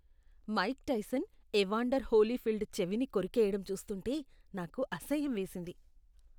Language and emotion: Telugu, disgusted